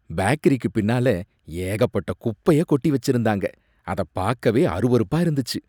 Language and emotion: Tamil, disgusted